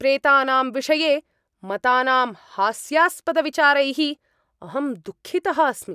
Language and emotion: Sanskrit, angry